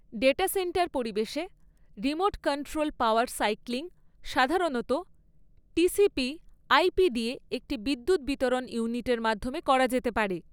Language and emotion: Bengali, neutral